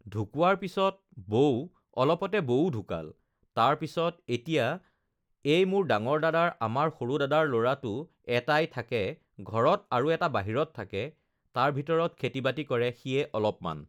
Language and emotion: Assamese, neutral